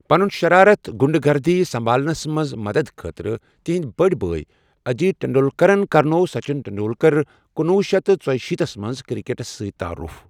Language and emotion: Kashmiri, neutral